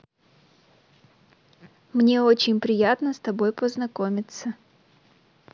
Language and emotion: Russian, neutral